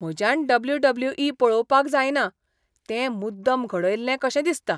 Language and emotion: Goan Konkani, disgusted